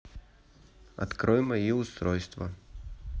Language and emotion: Russian, neutral